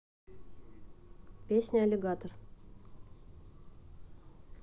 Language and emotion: Russian, neutral